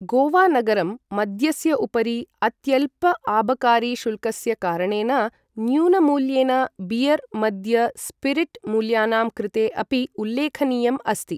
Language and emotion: Sanskrit, neutral